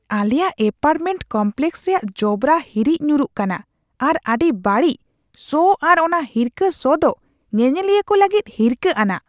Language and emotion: Santali, disgusted